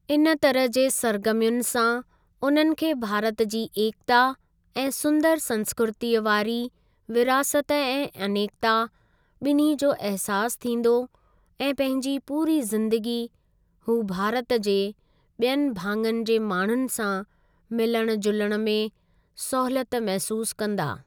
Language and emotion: Sindhi, neutral